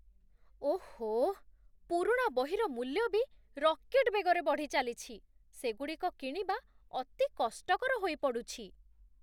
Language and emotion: Odia, surprised